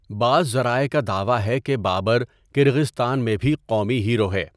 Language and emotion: Urdu, neutral